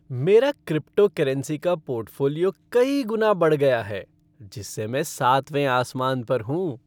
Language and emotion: Hindi, happy